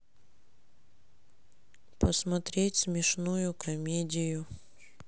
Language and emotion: Russian, sad